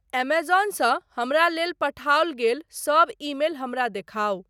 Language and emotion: Maithili, neutral